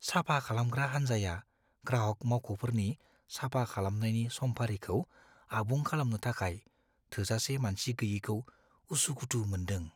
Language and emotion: Bodo, fearful